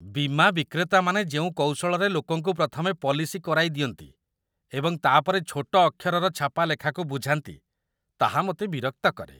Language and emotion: Odia, disgusted